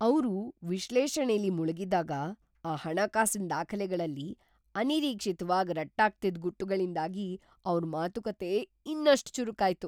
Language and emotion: Kannada, surprised